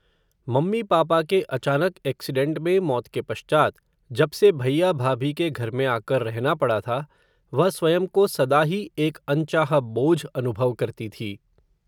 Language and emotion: Hindi, neutral